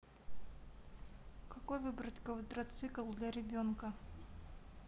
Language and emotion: Russian, neutral